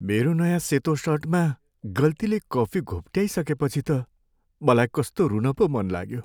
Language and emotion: Nepali, sad